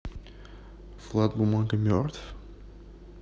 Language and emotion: Russian, neutral